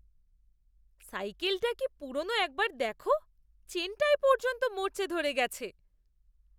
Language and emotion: Bengali, disgusted